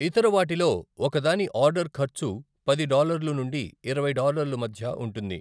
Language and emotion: Telugu, neutral